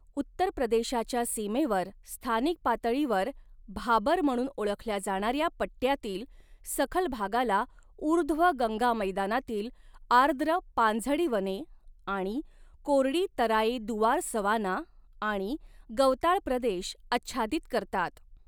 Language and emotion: Marathi, neutral